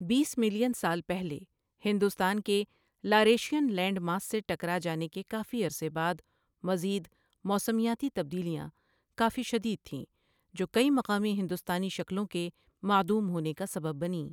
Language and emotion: Urdu, neutral